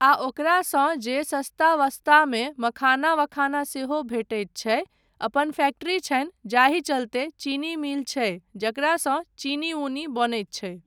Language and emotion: Maithili, neutral